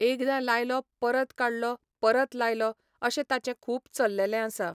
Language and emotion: Goan Konkani, neutral